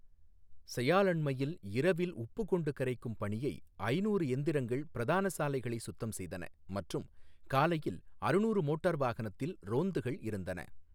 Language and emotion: Tamil, neutral